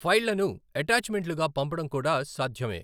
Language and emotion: Telugu, neutral